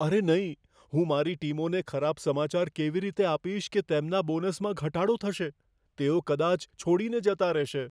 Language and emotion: Gujarati, fearful